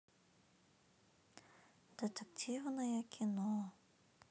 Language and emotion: Russian, sad